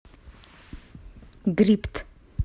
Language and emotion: Russian, neutral